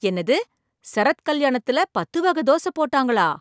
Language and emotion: Tamil, surprised